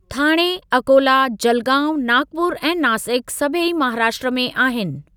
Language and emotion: Sindhi, neutral